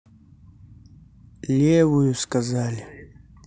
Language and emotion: Russian, sad